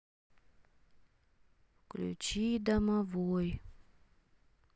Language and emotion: Russian, sad